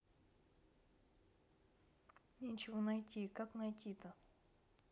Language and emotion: Russian, neutral